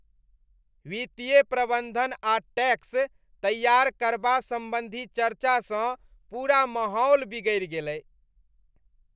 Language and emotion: Maithili, disgusted